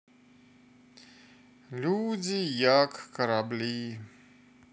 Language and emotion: Russian, neutral